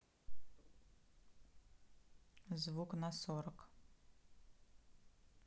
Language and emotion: Russian, neutral